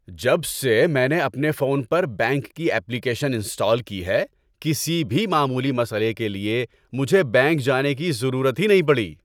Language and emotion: Urdu, happy